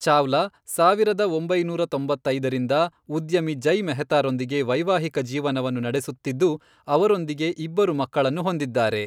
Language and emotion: Kannada, neutral